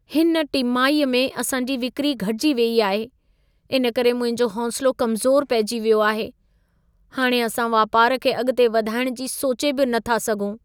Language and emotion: Sindhi, sad